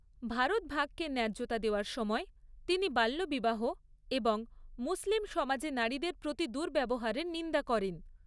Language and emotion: Bengali, neutral